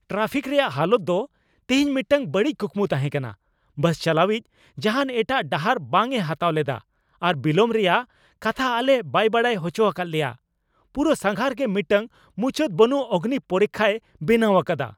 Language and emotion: Santali, angry